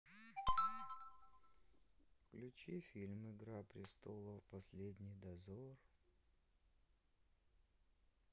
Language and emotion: Russian, sad